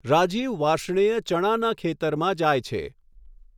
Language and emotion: Gujarati, neutral